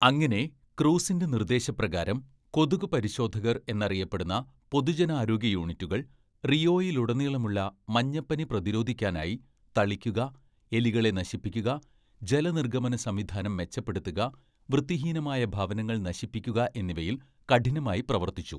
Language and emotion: Malayalam, neutral